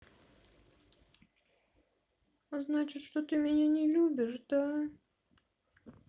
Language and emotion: Russian, sad